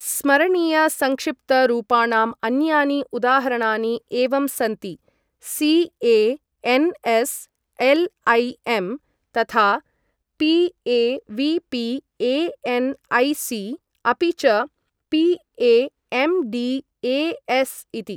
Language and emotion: Sanskrit, neutral